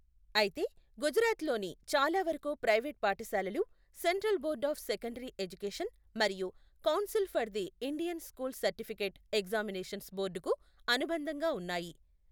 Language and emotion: Telugu, neutral